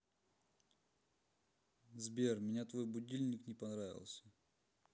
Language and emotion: Russian, neutral